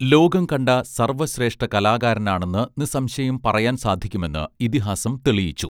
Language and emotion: Malayalam, neutral